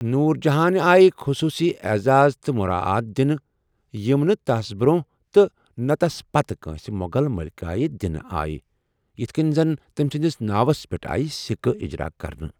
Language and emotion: Kashmiri, neutral